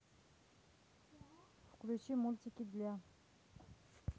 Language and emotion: Russian, neutral